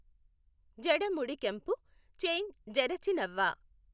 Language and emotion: Telugu, neutral